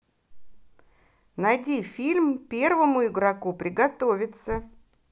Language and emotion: Russian, positive